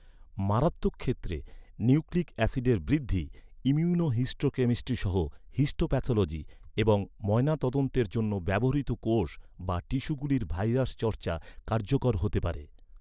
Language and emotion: Bengali, neutral